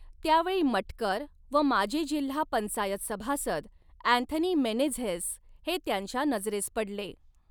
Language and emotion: Marathi, neutral